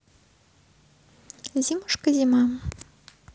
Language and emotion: Russian, neutral